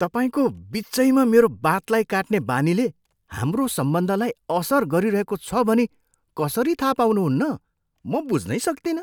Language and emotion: Nepali, surprised